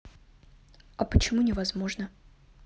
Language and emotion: Russian, neutral